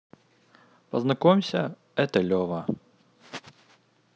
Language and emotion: Russian, neutral